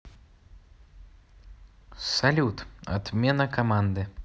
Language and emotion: Russian, neutral